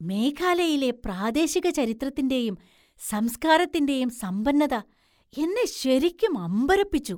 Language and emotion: Malayalam, surprised